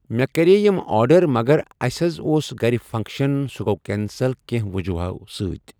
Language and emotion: Kashmiri, neutral